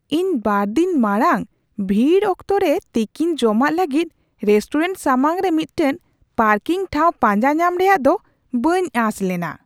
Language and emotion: Santali, surprised